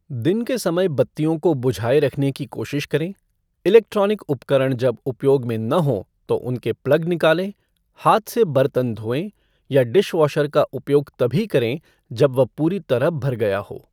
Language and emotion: Hindi, neutral